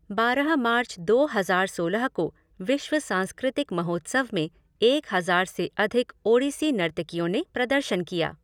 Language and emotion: Hindi, neutral